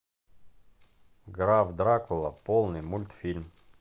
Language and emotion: Russian, neutral